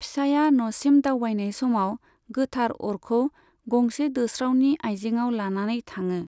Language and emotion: Bodo, neutral